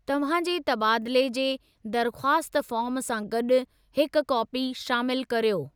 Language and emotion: Sindhi, neutral